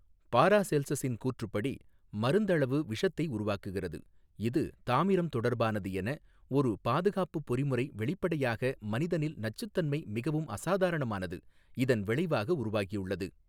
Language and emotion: Tamil, neutral